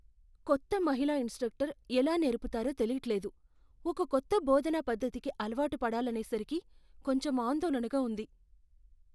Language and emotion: Telugu, fearful